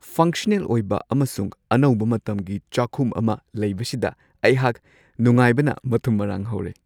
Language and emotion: Manipuri, happy